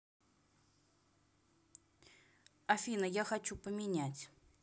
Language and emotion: Russian, neutral